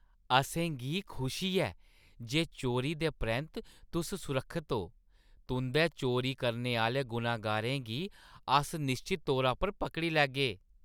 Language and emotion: Dogri, happy